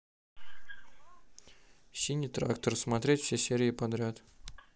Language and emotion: Russian, neutral